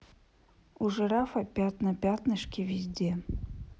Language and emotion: Russian, neutral